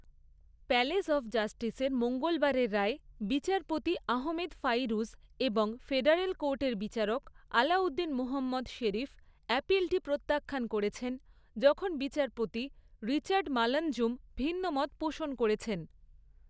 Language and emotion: Bengali, neutral